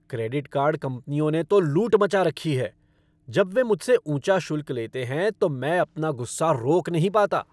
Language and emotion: Hindi, angry